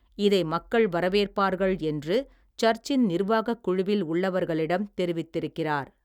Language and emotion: Tamil, neutral